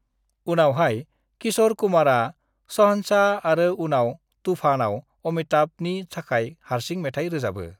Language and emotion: Bodo, neutral